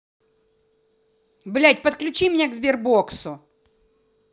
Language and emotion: Russian, angry